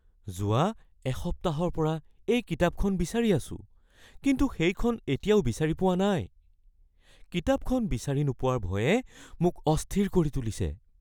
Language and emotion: Assamese, fearful